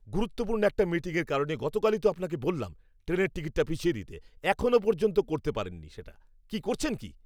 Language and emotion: Bengali, angry